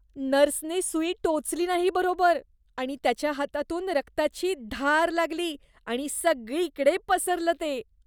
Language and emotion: Marathi, disgusted